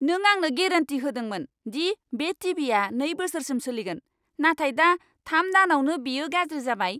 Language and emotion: Bodo, angry